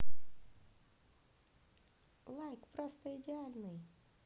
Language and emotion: Russian, positive